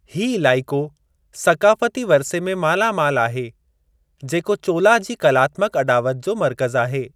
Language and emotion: Sindhi, neutral